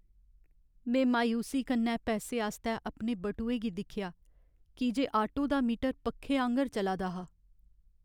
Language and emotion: Dogri, sad